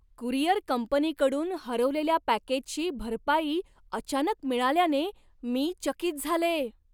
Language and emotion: Marathi, surprised